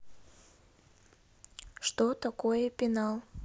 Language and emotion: Russian, neutral